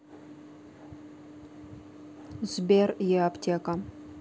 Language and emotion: Russian, neutral